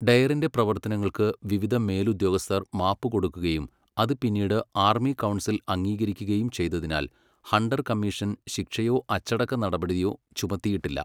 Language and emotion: Malayalam, neutral